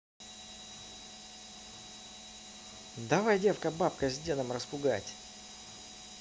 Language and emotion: Russian, positive